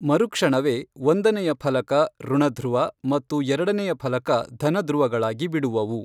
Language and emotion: Kannada, neutral